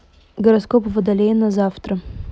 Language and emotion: Russian, neutral